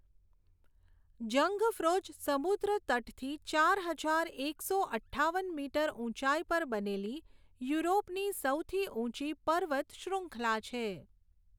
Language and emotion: Gujarati, neutral